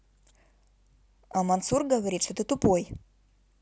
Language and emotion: Russian, neutral